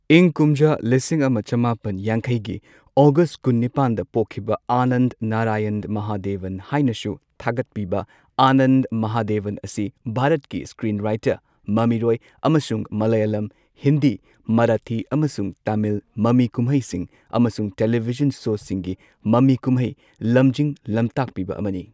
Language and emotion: Manipuri, neutral